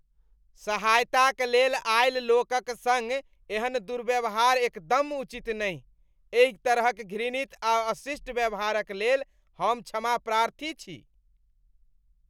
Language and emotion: Maithili, disgusted